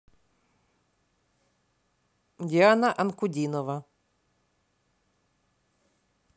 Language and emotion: Russian, neutral